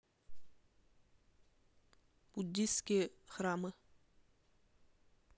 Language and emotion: Russian, neutral